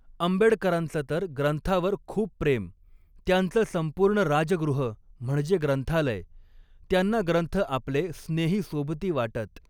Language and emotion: Marathi, neutral